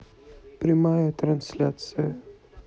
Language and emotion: Russian, neutral